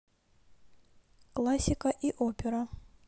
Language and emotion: Russian, neutral